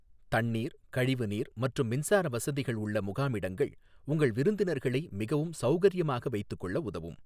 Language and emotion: Tamil, neutral